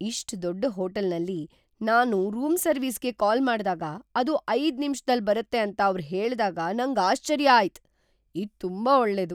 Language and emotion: Kannada, surprised